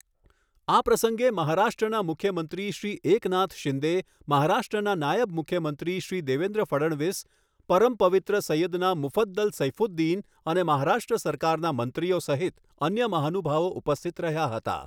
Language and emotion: Gujarati, neutral